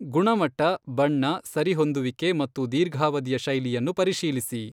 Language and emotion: Kannada, neutral